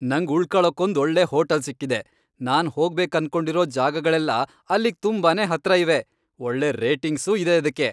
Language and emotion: Kannada, happy